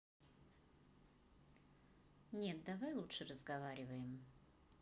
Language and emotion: Russian, neutral